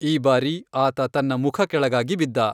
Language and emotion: Kannada, neutral